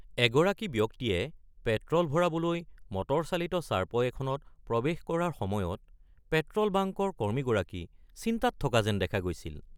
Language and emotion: Assamese, surprised